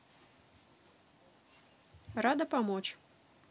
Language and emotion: Russian, neutral